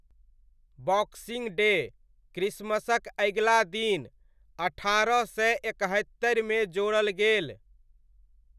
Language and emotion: Maithili, neutral